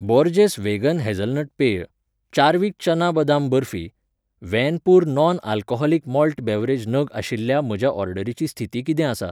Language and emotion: Goan Konkani, neutral